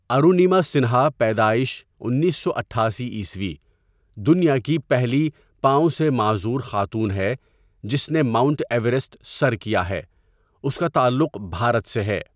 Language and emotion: Urdu, neutral